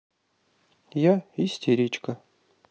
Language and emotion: Russian, neutral